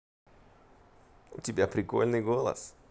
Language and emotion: Russian, positive